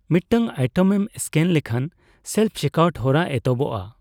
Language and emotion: Santali, neutral